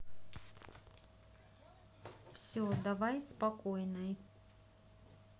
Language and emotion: Russian, neutral